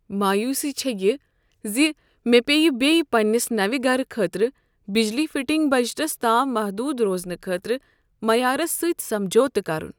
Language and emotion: Kashmiri, sad